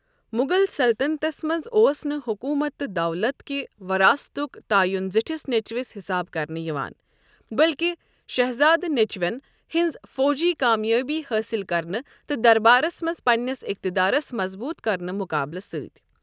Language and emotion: Kashmiri, neutral